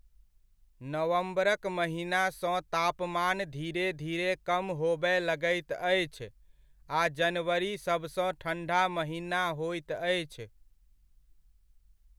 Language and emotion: Maithili, neutral